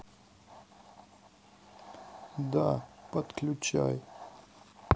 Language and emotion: Russian, sad